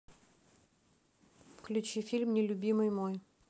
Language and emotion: Russian, neutral